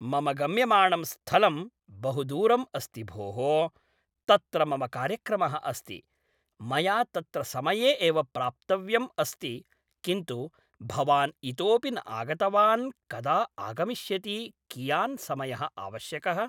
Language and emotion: Sanskrit, neutral